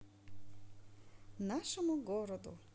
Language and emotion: Russian, positive